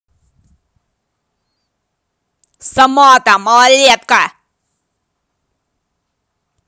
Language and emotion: Russian, angry